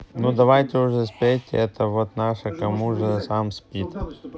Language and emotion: Russian, neutral